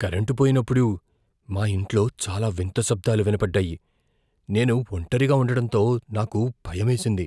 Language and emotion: Telugu, fearful